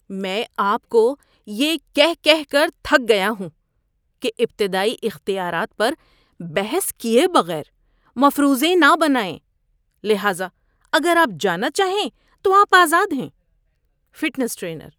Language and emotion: Urdu, disgusted